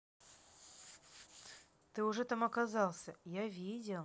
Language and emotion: Russian, neutral